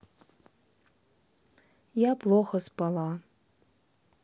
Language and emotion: Russian, sad